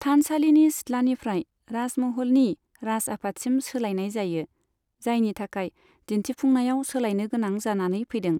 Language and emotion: Bodo, neutral